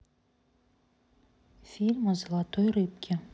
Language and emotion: Russian, neutral